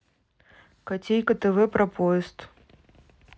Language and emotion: Russian, neutral